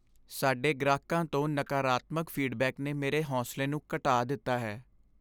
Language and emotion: Punjabi, sad